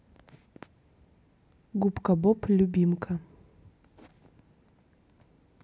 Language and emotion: Russian, neutral